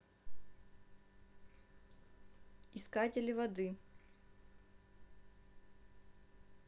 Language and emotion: Russian, neutral